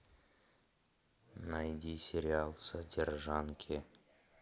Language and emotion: Russian, neutral